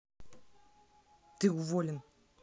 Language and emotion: Russian, angry